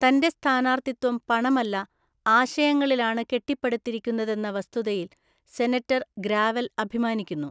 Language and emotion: Malayalam, neutral